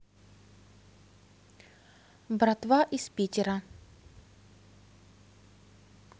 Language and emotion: Russian, neutral